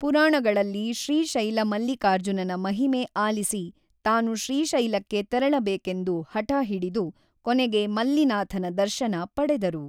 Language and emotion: Kannada, neutral